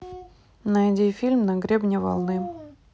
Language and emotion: Russian, neutral